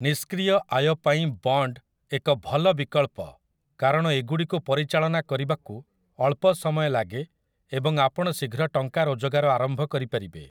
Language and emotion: Odia, neutral